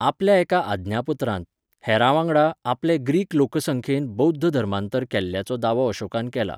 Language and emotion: Goan Konkani, neutral